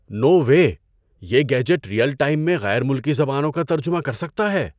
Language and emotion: Urdu, surprised